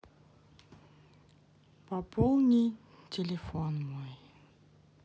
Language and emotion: Russian, sad